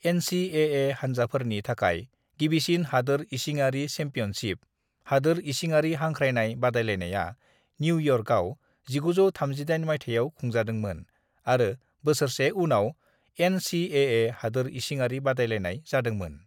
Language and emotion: Bodo, neutral